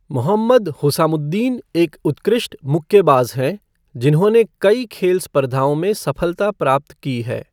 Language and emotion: Hindi, neutral